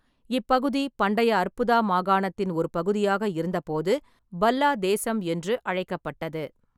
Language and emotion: Tamil, neutral